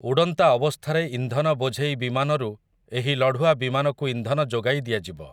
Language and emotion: Odia, neutral